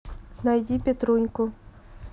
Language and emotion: Russian, neutral